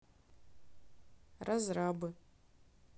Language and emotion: Russian, neutral